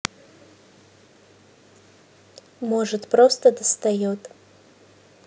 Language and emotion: Russian, neutral